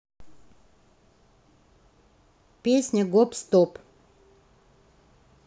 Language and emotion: Russian, neutral